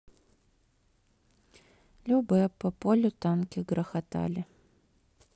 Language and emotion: Russian, sad